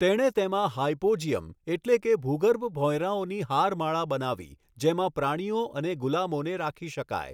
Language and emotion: Gujarati, neutral